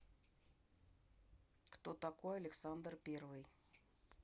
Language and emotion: Russian, neutral